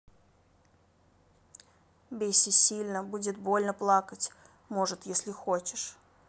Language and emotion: Russian, neutral